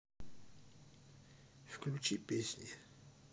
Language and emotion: Russian, neutral